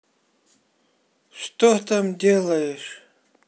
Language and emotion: Russian, angry